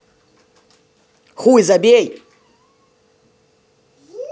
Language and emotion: Russian, angry